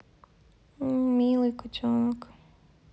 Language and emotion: Russian, neutral